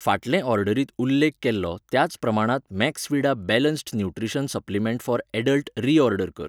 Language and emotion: Goan Konkani, neutral